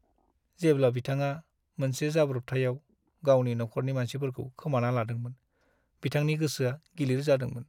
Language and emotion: Bodo, sad